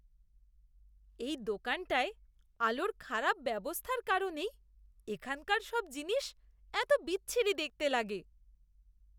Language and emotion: Bengali, disgusted